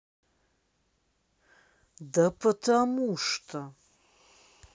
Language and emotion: Russian, angry